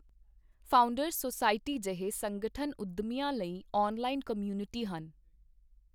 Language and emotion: Punjabi, neutral